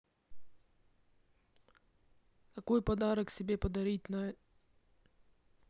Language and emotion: Russian, neutral